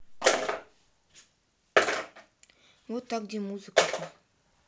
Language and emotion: Russian, neutral